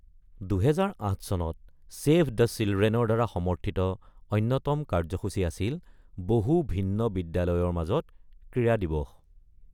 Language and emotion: Assamese, neutral